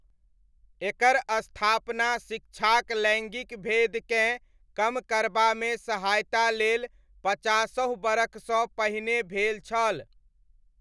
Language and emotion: Maithili, neutral